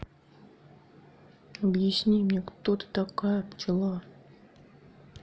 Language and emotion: Russian, sad